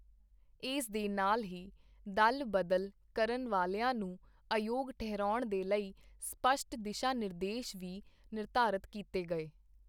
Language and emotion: Punjabi, neutral